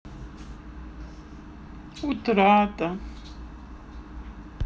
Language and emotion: Russian, sad